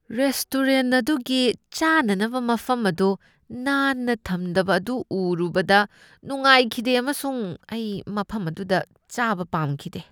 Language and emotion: Manipuri, disgusted